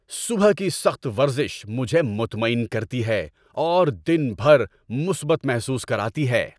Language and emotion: Urdu, happy